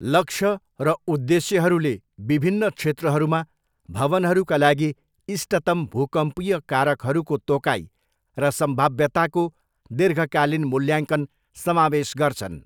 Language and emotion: Nepali, neutral